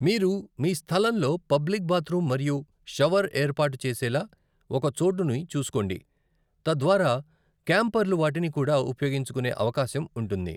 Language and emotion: Telugu, neutral